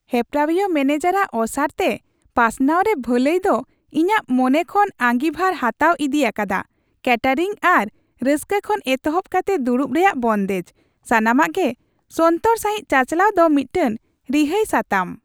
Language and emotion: Santali, happy